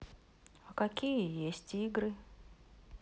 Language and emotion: Russian, neutral